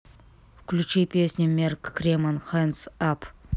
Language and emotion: Russian, neutral